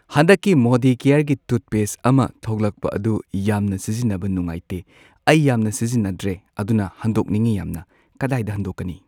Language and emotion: Manipuri, neutral